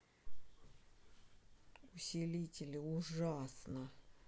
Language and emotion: Russian, angry